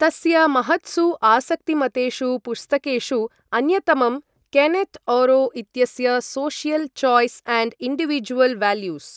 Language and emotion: Sanskrit, neutral